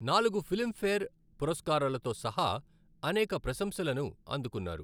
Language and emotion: Telugu, neutral